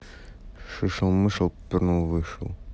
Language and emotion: Russian, neutral